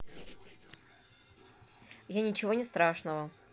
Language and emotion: Russian, neutral